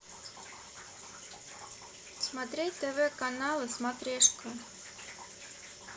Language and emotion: Russian, neutral